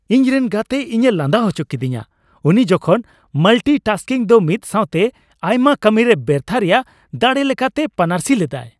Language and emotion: Santali, happy